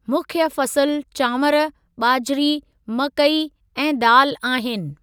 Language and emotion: Sindhi, neutral